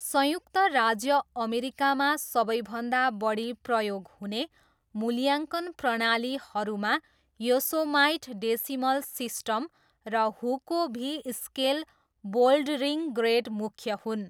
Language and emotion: Nepali, neutral